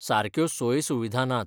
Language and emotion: Goan Konkani, neutral